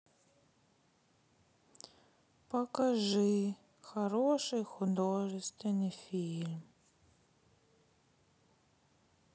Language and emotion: Russian, sad